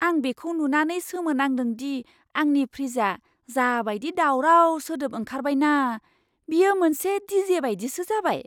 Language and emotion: Bodo, surprised